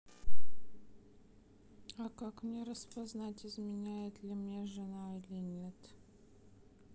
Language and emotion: Russian, sad